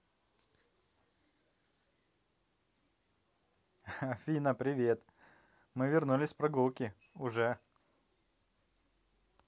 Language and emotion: Russian, positive